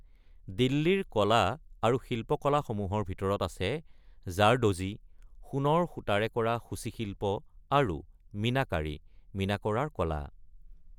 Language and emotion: Assamese, neutral